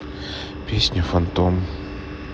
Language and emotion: Russian, neutral